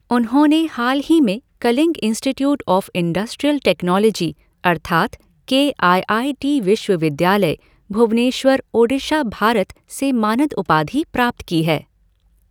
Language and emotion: Hindi, neutral